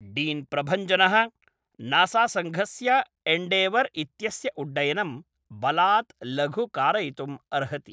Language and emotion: Sanskrit, neutral